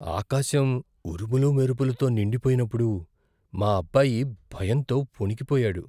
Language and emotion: Telugu, fearful